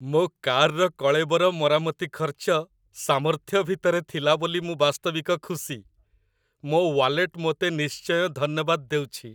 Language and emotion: Odia, happy